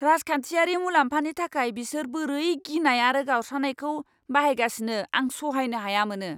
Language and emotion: Bodo, angry